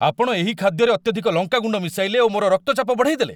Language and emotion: Odia, angry